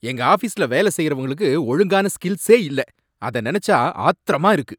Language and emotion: Tamil, angry